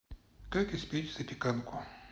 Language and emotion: Russian, neutral